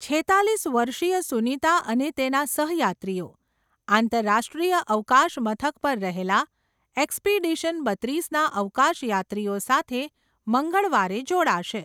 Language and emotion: Gujarati, neutral